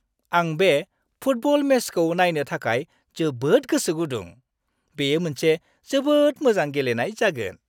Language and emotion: Bodo, happy